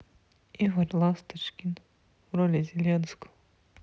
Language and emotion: Russian, sad